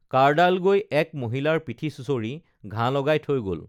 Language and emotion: Assamese, neutral